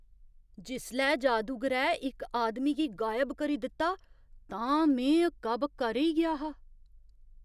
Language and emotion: Dogri, surprised